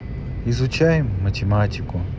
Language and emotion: Russian, neutral